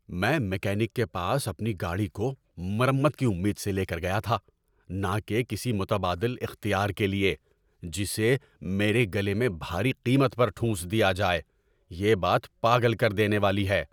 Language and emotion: Urdu, angry